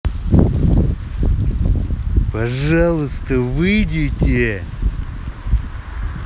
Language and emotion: Russian, angry